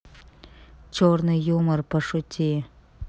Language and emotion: Russian, neutral